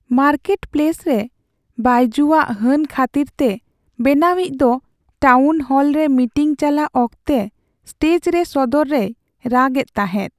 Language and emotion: Santali, sad